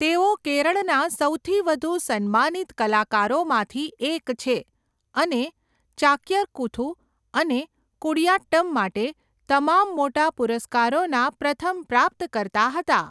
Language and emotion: Gujarati, neutral